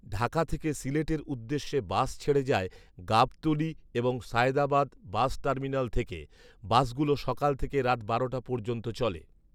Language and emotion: Bengali, neutral